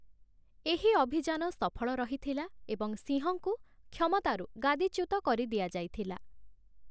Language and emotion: Odia, neutral